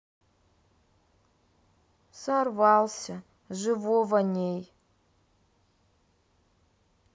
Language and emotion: Russian, sad